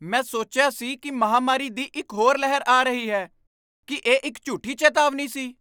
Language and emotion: Punjabi, surprised